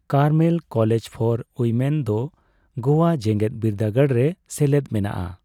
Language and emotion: Santali, neutral